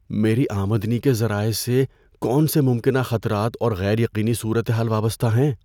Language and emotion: Urdu, fearful